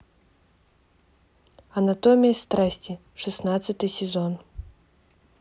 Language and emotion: Russian, neutral